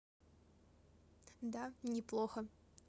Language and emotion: Russian, neutral